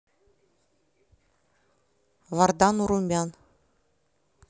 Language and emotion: Russian, neutral